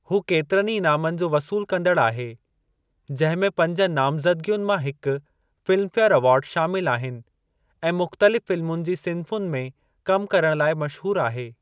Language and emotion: Sindhi, neutral